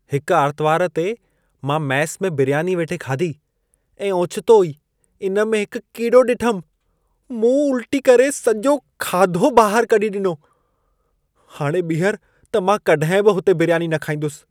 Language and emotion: Sindhi, disgusted